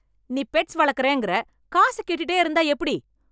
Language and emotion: Tamil, angry